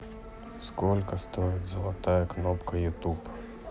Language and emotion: Russian, neutral